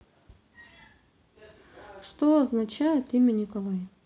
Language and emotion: Russian, neutral